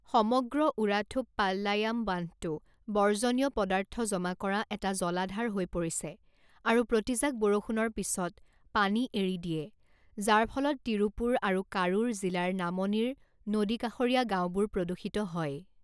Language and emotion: Assamese, neutral